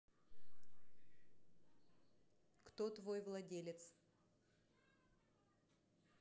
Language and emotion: Russian, neutral